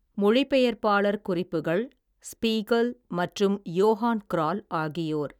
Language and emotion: Tamil, neutral